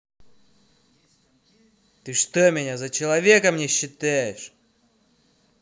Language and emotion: Russian, angry